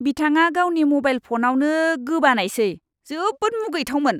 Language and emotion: Bodo, disgusted